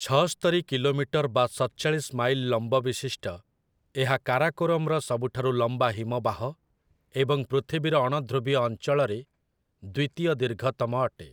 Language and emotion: Odia, neutral